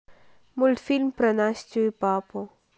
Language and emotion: Russian, neutral